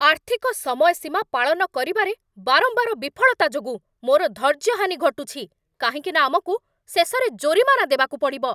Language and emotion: Odia, angry